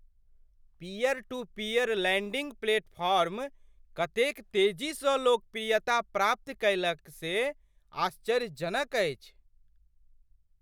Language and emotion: Maithili, surprised